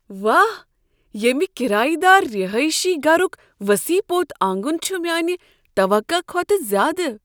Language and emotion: Kashmiri, surprised